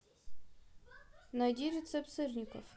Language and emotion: Russian, neutral